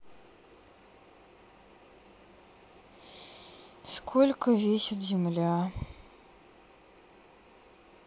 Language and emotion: Russian, sad